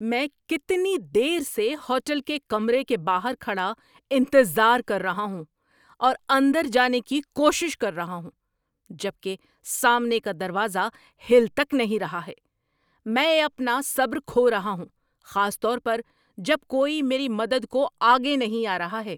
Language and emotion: Urdu, angry